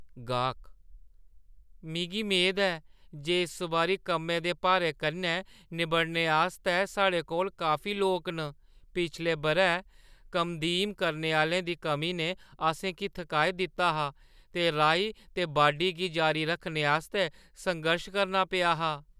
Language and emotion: Dogri, fearful